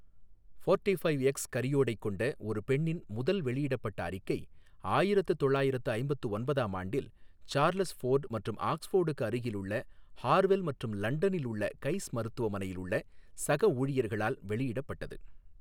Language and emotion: Tamil, neutral